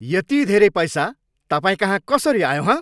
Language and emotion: Nepali, angry